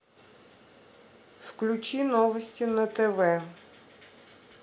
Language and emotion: Russian, neutral